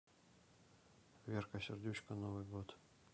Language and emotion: Russian, neutral